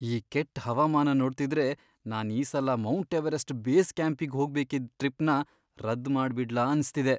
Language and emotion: Kannada, fearful